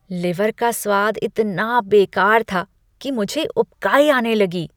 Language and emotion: Hindi, disgusted